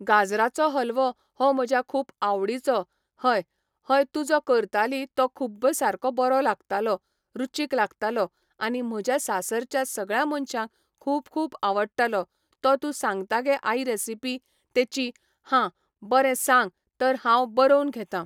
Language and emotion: Goan Konkani, neutral